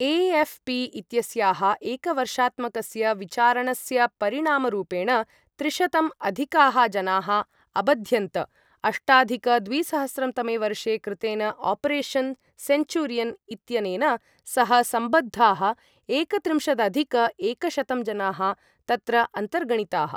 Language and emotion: Sanskrit, neutral